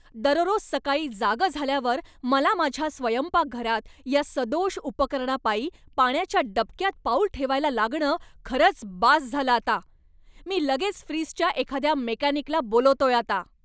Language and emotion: Marathi, angry